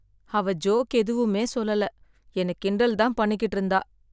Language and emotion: Tamil, sad